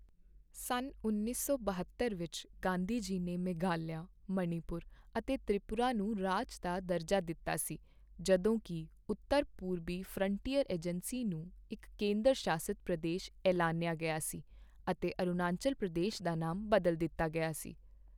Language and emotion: Punjabi, neutral